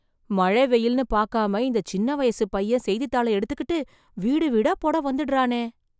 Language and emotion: Tamil, surprised